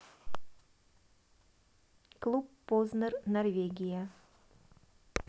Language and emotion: Russian, neutral